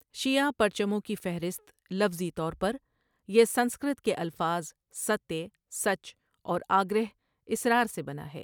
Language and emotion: Urdu, neutral